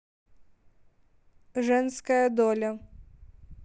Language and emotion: Russian, neutral